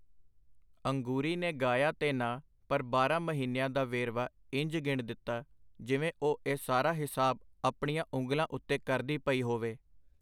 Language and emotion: Punjabi, neutral